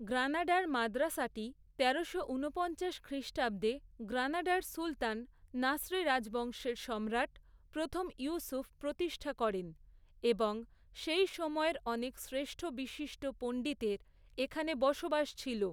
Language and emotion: Bengali, neutral